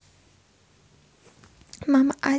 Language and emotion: Russian, neutral